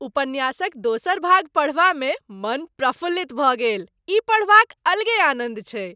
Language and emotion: Maithili, happy